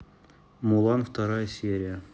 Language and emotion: Russian, neutral